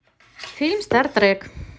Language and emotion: Russian, positive